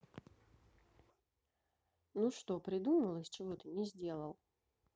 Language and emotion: Russian, neutral